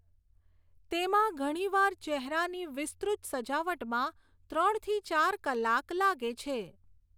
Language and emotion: Gujarati, neutral